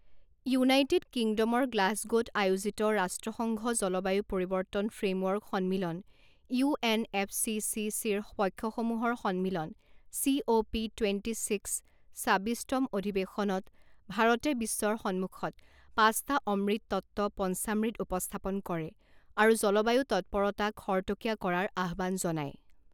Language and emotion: Assamese, neutral